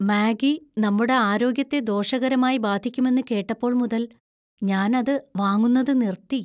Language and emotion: Malayalam, fearful